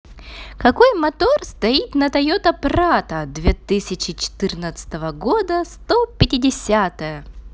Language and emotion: Russian, positive